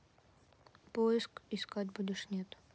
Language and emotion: Russian, neutral